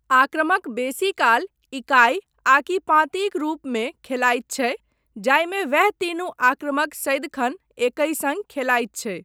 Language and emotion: Maithili, neutral